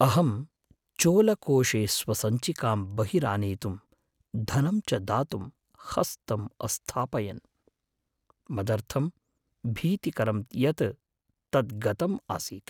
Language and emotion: Sanskrit, fearful